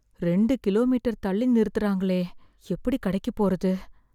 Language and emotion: Tamil, fearful